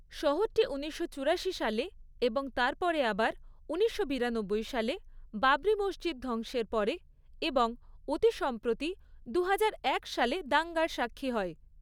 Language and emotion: Bengali, neutral